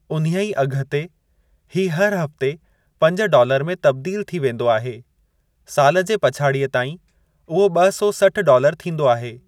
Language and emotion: Sindhi, neutral